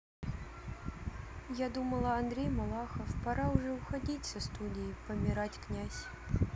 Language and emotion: Russian, sad